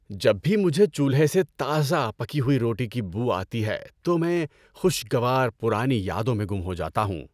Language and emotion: Urdu, happy